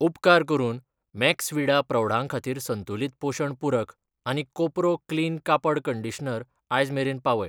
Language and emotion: Goan Konkani, neutral